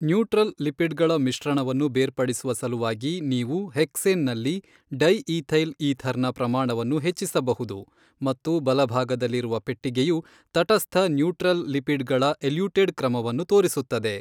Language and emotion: Kannada, neutral